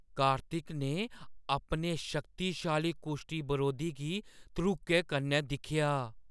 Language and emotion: Dogri, fearful